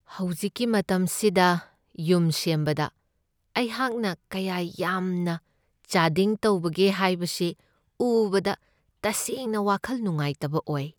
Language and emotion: Manipuri, sad